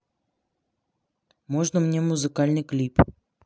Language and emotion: Russian, neutral